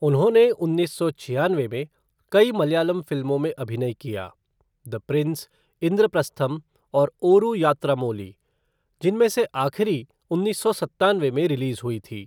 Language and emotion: Hindi, neutral